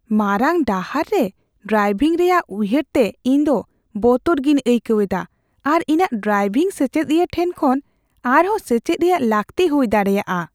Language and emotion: Santali, fearful